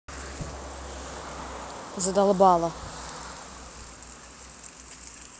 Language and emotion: Russian, angry